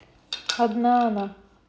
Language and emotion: Russian, neutral